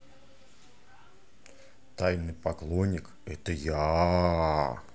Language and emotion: Russian, positive